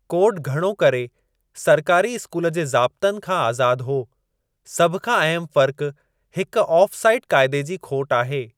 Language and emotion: Sindhi, neutral